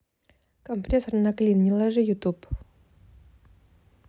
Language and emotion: Russian, neutral